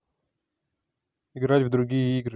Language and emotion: Russian, neutral